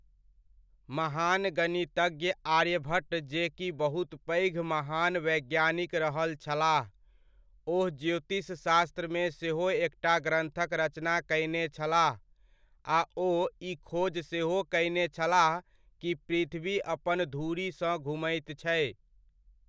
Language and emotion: Maithili, neutral